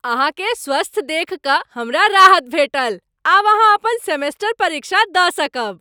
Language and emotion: Maithili, happy